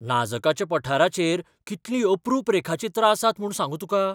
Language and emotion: Goan Konkani, surprised